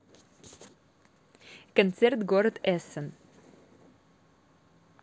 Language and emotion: Russian, positive